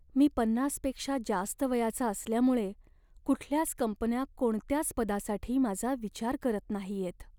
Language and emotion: Marathi, sad